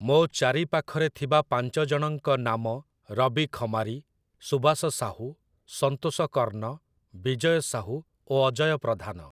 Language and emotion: Odia, neutral